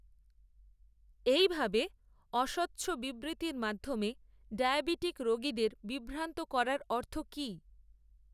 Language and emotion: Bengali, neutral